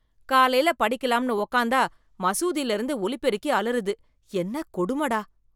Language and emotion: Tamil, disgusted